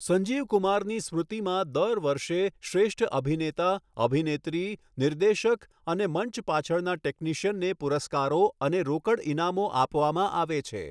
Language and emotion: Gujarati, neutral